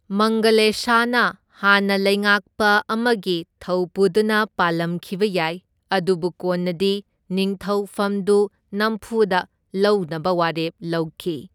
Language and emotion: Manipuri, neutral